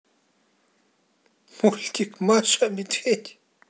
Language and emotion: Russian, positive